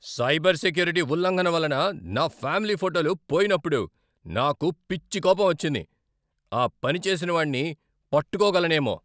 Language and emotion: Telugu, angry